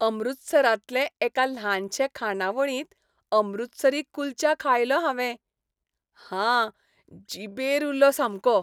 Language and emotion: Goan Konkani, happy